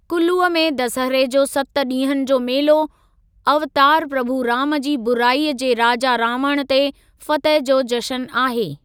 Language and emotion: Sindhi, neutral